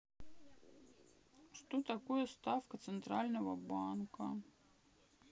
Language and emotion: Russian, sad